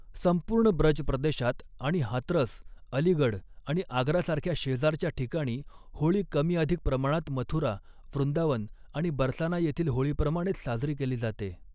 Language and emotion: Marathi, neutral